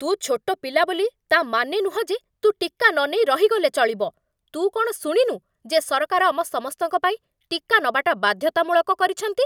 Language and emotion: Odia, angry